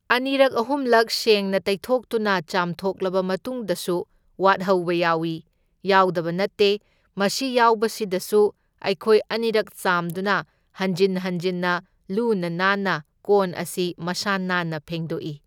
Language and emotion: Manipuri, neutral